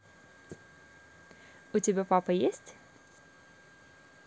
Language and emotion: Russian, positive